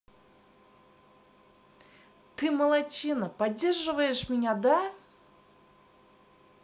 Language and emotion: Russian, positive